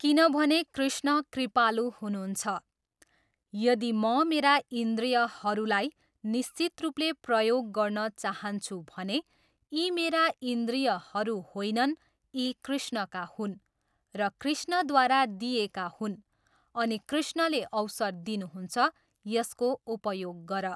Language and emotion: Nepali, neutral